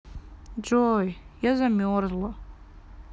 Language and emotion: Russian, sad